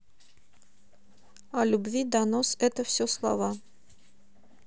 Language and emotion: Russian, neutral